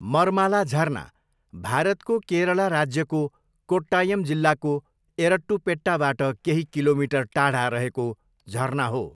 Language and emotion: Nepali, neutral